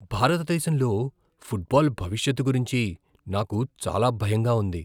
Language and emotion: Telugu, fearful